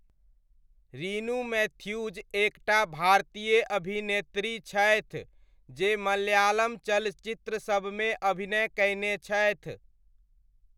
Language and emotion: Maithili, neutral